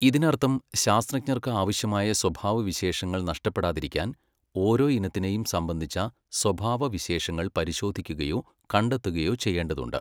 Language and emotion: Malayalam, neutral